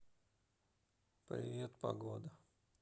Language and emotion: Russian, neutral